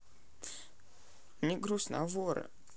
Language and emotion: Russian, sad